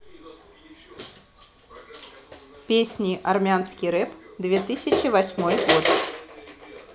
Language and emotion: Russian, neutral